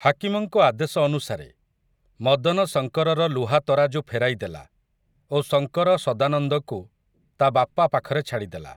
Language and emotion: Odia, neutral